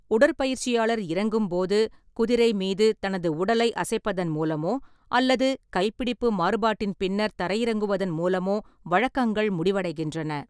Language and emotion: Tamil, neutral